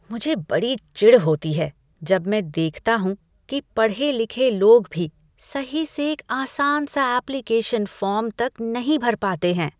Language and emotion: Hindi, disgusted